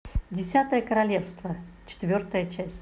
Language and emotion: Russian, positive